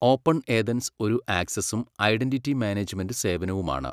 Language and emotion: Malayalam, neutral